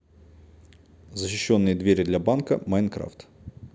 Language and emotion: Russian, neutral